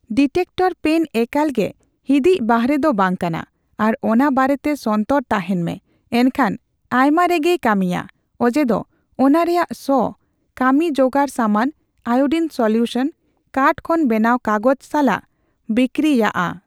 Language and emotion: Santali, neutral